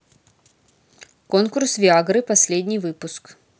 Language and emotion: Russian, neutral